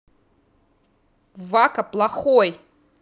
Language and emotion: Russian, angry